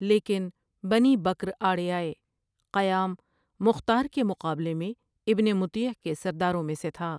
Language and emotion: Urdu, neutral